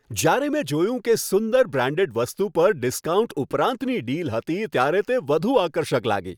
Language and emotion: Gujarati, happy